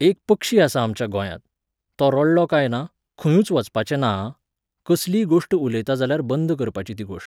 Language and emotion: Goan Konkani, neutral